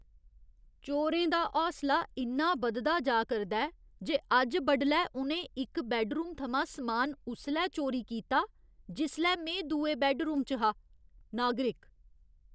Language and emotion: Dogri, disgusted